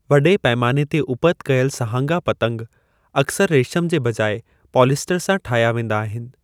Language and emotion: Sindhi, neutral